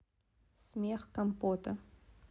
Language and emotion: Russian, neutral